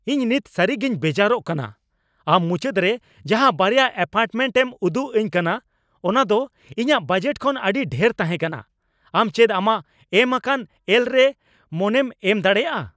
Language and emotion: Santali, angry